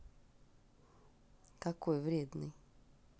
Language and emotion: Russian, neutral